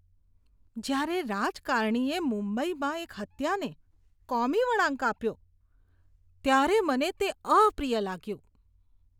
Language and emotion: Gujarati, disgusted